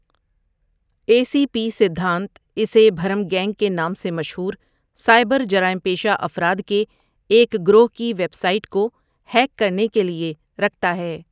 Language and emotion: Urdu, neutral